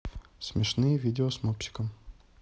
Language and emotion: Russian, neutral